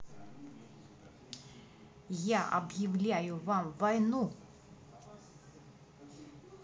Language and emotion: Russian, angry